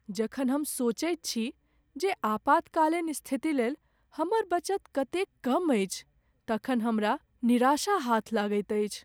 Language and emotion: Maithili, sad